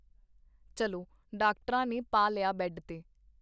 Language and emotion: Punjabi, neutral